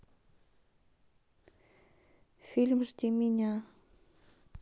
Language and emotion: Russian, neutral